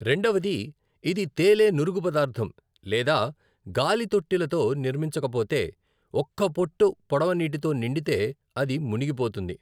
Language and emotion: Telugu, neutral